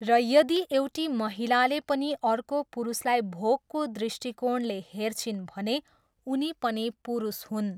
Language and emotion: Nepali, neutral